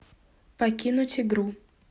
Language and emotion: Russian, neutral